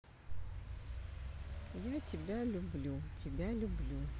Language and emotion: Russian, neutral